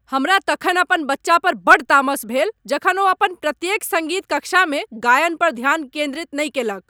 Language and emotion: Maithili, angry